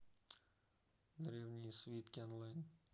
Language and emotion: Russian, neutral